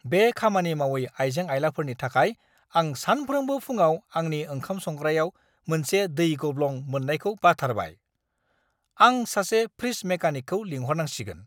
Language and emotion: Bodo, angry